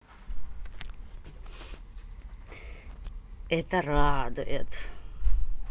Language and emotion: Russian, positive